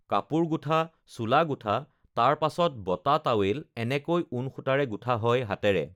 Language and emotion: Assamese, neutral